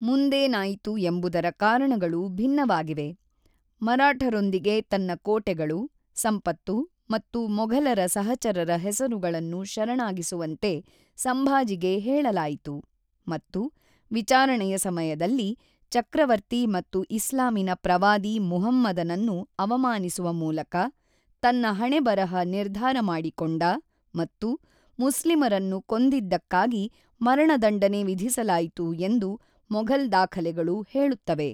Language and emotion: Kannada, neutral